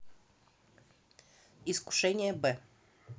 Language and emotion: Russian, neutral